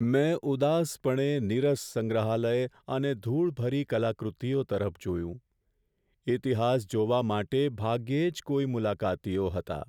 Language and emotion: Gujarati, sad